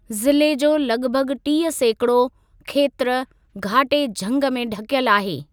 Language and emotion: Sindhi, neutral